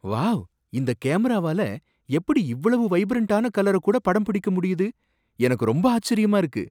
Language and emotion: Tamil, surprised